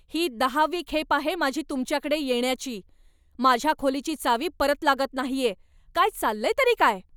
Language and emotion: Marathi, angry